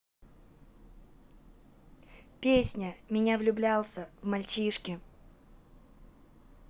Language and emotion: Russian, neutral